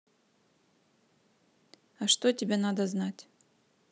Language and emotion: Russian, neutral